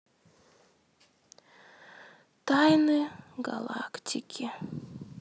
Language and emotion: Russian, sad